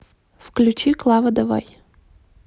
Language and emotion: Russian, neutral